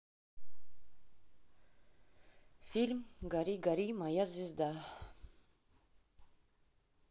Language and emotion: Russian, neutral